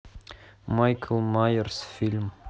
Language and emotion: Russian, neutral